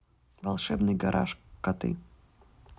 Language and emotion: Russian, neutral